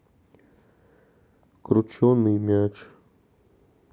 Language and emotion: Russian, sad